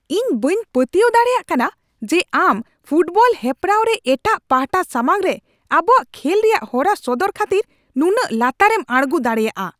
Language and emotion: Santali, angry